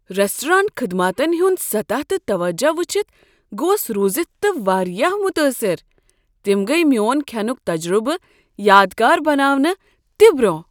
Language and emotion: Kashmiri, surprised